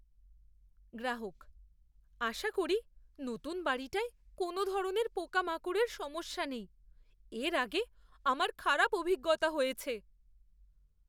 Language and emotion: Bengali, fearful